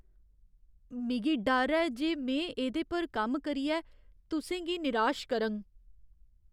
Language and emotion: Dogri, fearful